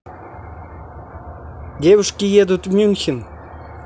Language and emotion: Russian, neutral